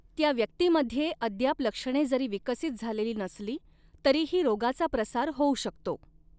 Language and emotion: Marathi, neutral